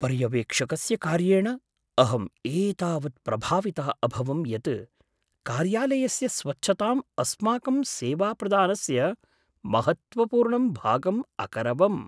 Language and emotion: Sanskrit, surprised